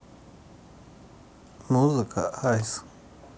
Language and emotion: Russian, neutral